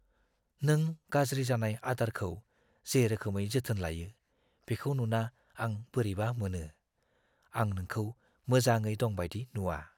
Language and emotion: Bodo, fearful